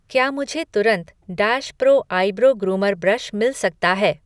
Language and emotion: Hindi, neutral